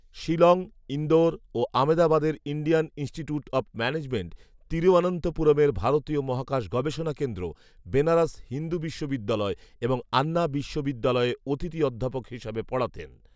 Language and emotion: Bengali, neutral